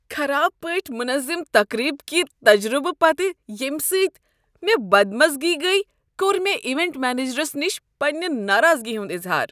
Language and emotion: Kashmiri, disgusted